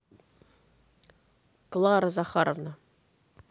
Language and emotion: Russian, neutral